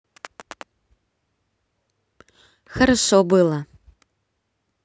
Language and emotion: Russian, positive